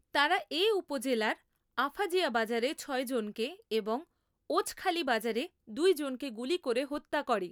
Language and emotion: Bengali, neutral